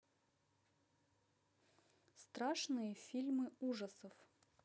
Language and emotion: Russian, neutral